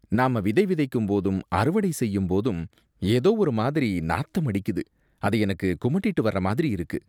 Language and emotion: Tamil, disgusted